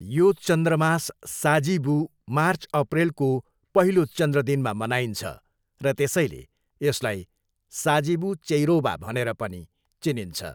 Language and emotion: Nepali, neutral